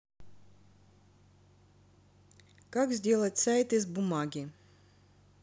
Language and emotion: Russian, neutral